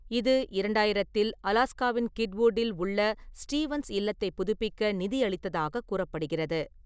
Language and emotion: Tamil, neutral